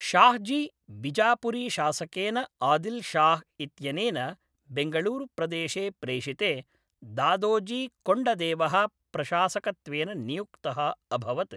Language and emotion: Sanskrit, neutral